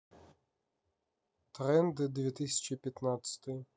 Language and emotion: Russian, neutral